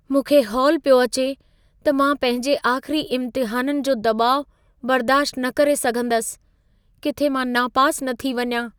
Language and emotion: Sindhi, fearful